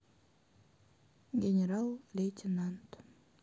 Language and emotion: Russian, sad